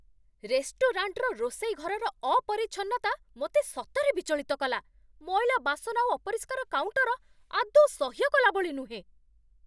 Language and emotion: Odia, angry